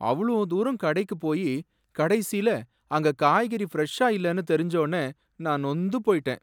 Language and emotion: Tamil, sad